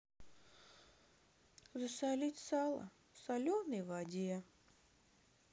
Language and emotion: Russian, sad